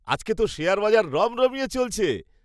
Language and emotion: Bengali, happy